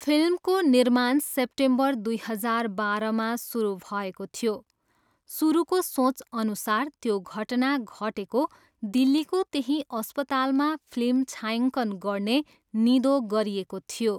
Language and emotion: Nepali, neutral